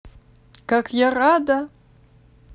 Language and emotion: Russian, positive